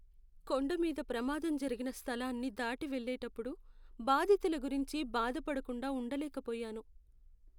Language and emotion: Telugu, sad